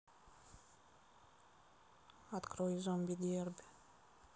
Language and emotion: Russian, neutral